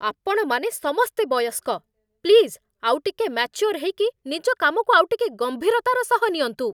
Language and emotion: Odia, angry